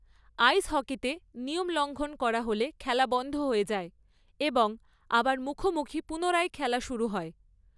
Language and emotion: Bengali, neutral